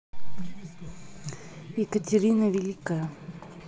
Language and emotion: Russian, neutral